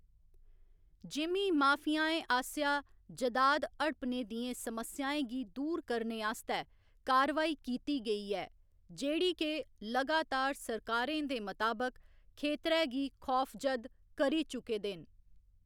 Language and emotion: Dogri, neutral